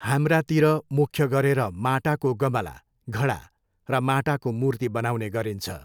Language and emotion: Nepali, neutral